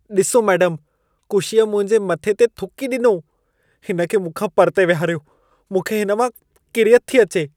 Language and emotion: Sindhi, disgusted